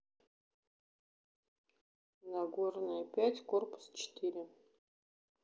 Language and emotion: Russian, neutral